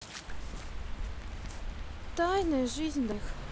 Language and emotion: Russian, sad